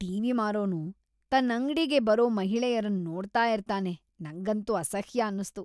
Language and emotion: Kannada, disgusted